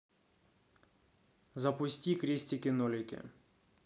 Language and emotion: Russian, neutral